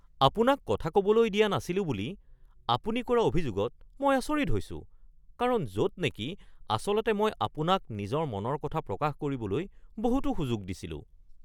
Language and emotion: Assamese, surprised